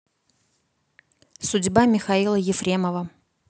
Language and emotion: Russian, neutral